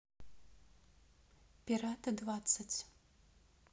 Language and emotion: Russian, neutral